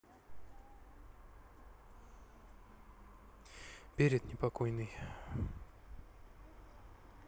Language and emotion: Russian, sad